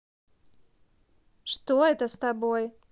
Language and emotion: Russian, neutral